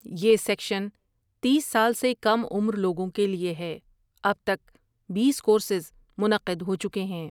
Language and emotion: Urdu, neutral